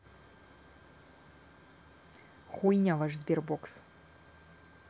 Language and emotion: Russian, angry